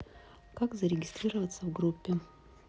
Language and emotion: Russian, neutral